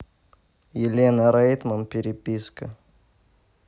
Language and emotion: Russian, neutral